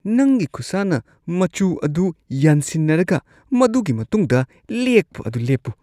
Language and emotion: Manipuri, disgusted